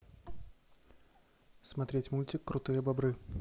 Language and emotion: Russian, neutral